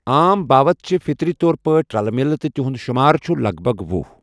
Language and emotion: Kashmiri, neutral